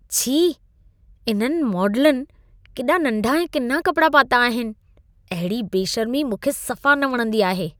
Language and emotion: Sindhi, disgusted